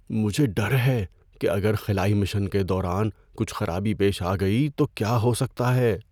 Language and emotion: Urdu, fearful